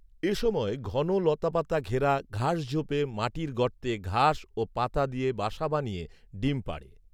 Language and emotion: Bengali, neutral